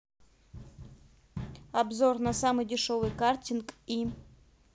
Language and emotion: Russian, neutral